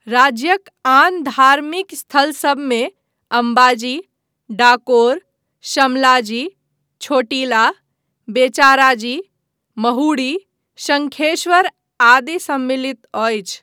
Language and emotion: Maithili, neutral